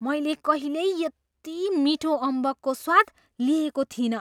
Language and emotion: Nepali, surprised